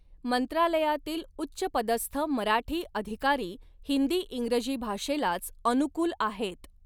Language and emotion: Marathi, neutral